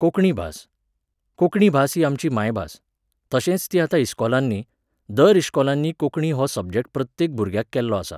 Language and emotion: Goan Konkani, neutral